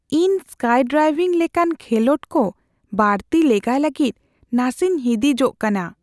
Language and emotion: Santali, fearful